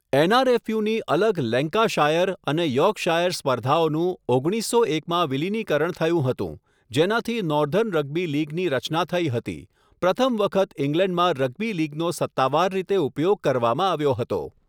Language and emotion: Gujarati, neutral